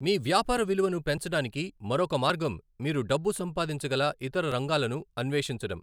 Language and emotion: Telugu, neutral